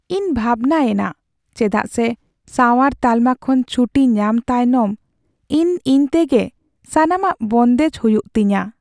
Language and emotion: Santali, sad